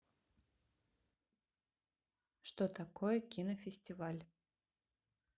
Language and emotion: Russian, neutral